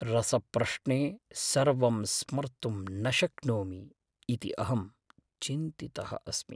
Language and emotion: Sanskrit, fearful